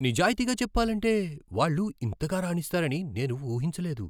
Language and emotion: Telugu, surprised